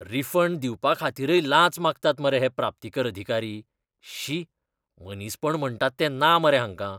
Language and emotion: Goan Konkani, disgusted